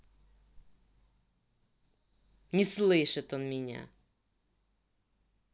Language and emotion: Russian, angry